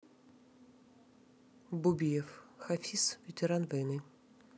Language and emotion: Russian, neutral